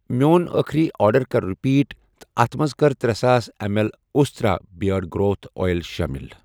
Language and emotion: Kashmiri, neutral